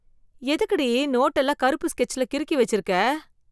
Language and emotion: Tamil, disgusted